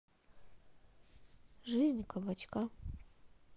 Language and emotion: Russian, neutral